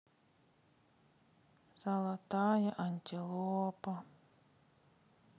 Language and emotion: Russian, sad